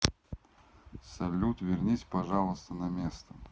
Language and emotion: Russian, neutral